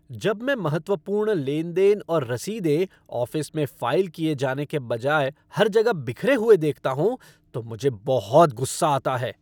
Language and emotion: Hindi, angry